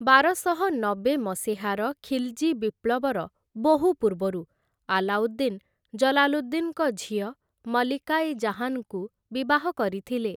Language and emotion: Odia, neutral